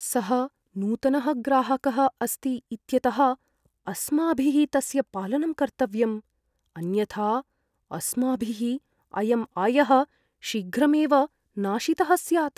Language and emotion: Sanskrit, fearful